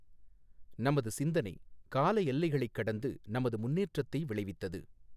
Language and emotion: Tamil, neutral